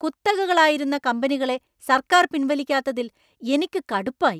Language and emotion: Malayalam, angry